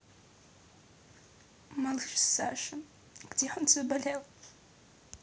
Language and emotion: Russian, sad